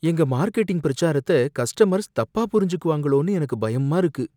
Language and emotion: Tamil, fearful